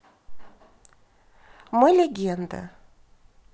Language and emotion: Russian, neutral